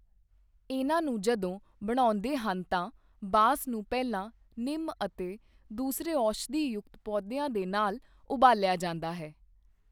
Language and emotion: Punjabi, neutral